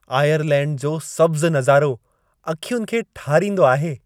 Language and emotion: Sindhi, happy